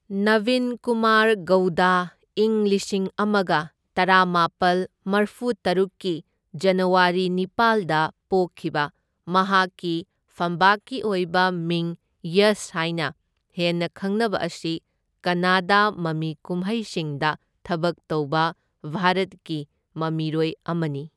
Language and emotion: Manipuri, neutral